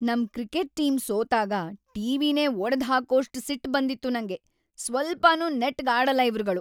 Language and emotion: Kannada, angry